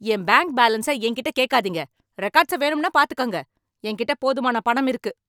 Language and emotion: Tamil, angry